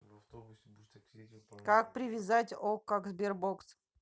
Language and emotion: Russian, neutral